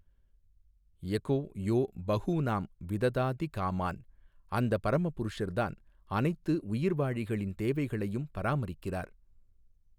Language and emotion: Tamil, neutral